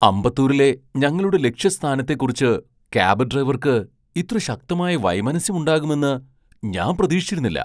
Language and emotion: Malayalam, surprised